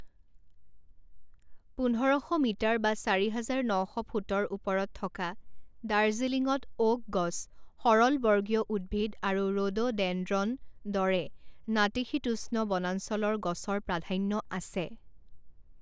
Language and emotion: Assamese, neutral